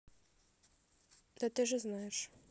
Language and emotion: Russian, neutral